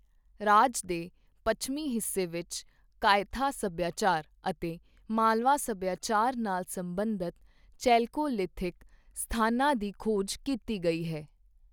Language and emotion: Punjabi, neutral